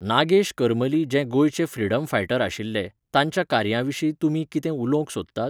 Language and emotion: Goan Konkani, neutral